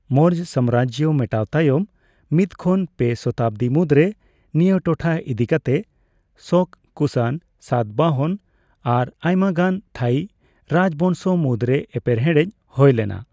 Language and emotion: Santali, neutral